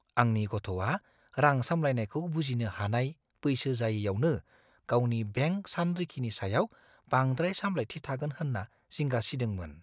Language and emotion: Bodo, fearful